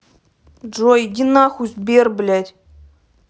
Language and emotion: Russian, angry